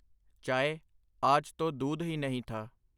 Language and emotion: Punjabi, neutral